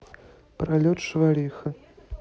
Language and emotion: Russian, neutral